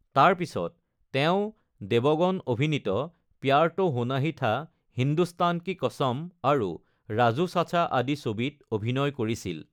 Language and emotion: Assamese, neutral